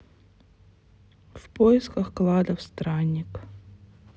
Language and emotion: Russian, neutral